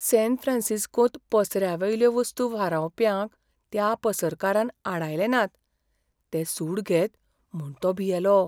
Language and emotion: Goan Konkani, fearful